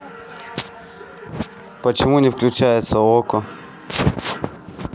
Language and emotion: Russian, neutral